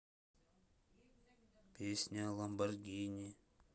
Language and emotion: Russian, neutral